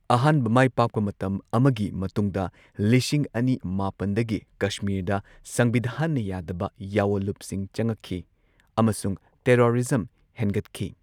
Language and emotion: Manipuri, neutral